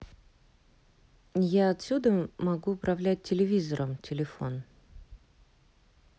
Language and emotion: Russian, neutral